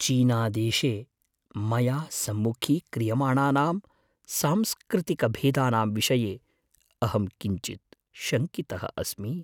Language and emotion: Sanskrit, fearful